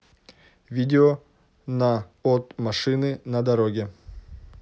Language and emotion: Russian, neutral